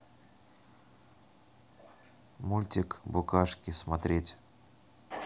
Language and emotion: Russian, neutral